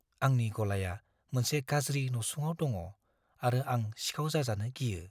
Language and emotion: Bodo, fearful